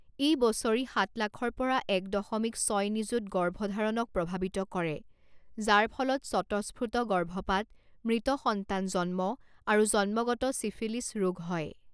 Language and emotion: Assamese, neutral